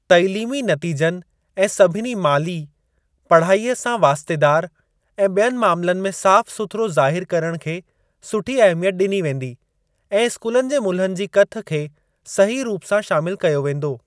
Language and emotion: Sindhi, neutral